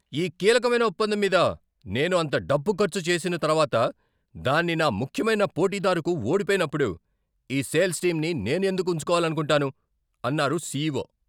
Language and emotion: Telugu, angry